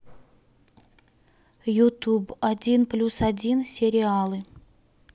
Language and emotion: Russian, neutral